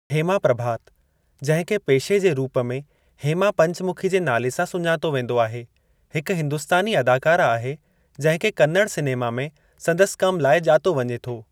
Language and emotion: Sindhi, neutral